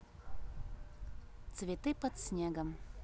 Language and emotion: Russian, neutral